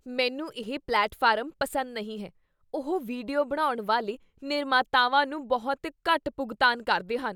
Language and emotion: Punjabi, disgusted